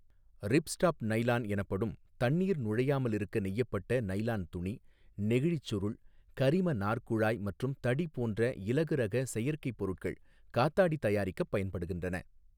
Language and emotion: Tamil, neutral